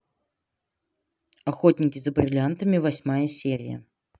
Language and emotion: Russian, neutral